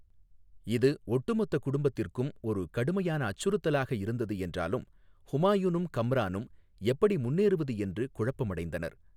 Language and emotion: Tamil, neutral